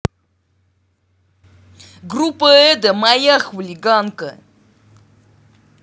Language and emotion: Russian, angry